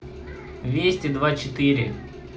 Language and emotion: Russian, neutral